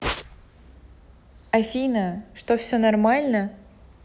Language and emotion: Russian, neutral